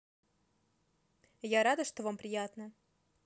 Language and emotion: Russian, positive